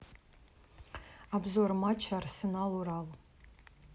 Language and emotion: Russian, neutral